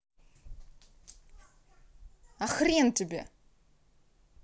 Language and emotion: Russian, angry